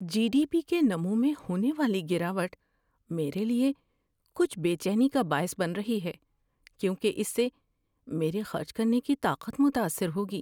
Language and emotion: Urdu, fearful